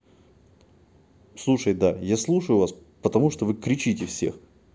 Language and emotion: Russian, angry